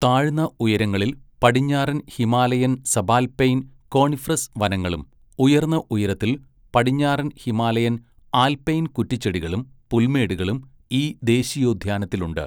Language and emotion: Malayalam, neutral